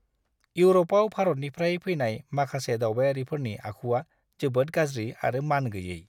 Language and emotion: Bodo, disgusted